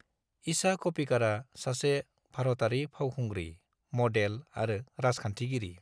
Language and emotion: Bodo, neutral